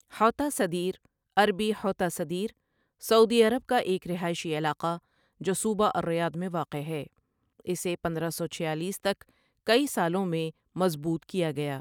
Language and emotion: Urdu, neutral